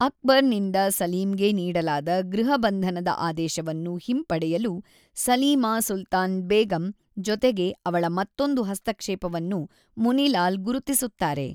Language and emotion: Kannada, neutral